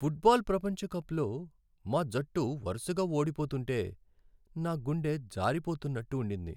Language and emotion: Telugu, sad